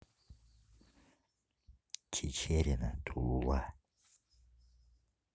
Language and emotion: Russian, neutral